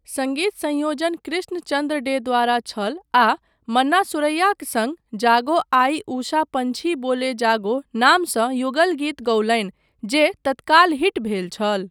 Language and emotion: Maithili, neutral